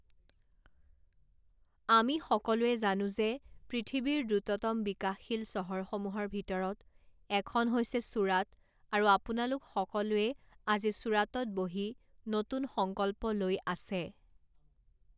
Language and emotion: Assamese, neutral